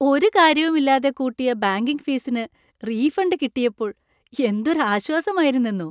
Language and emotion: Malayalam, happy